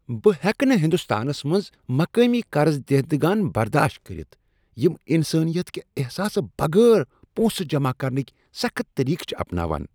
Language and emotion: Kashmiri, disgusted